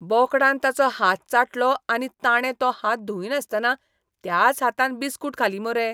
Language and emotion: Goan Konkani, disgusted